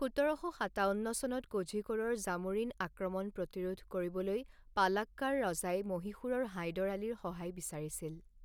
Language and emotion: Assamese, neutral